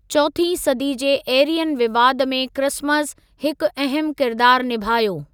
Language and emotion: Sindhi, neutral